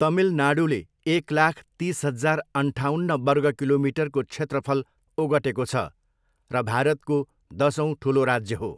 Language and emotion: Nepali, neutral